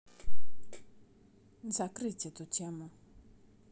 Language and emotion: Russian, neutral